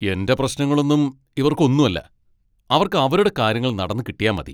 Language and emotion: Malayalam, angry